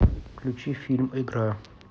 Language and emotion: Russian, neutral